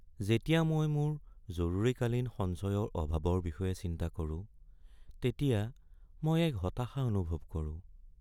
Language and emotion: Assamese, sad